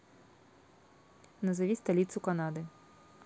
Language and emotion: Russian, neutral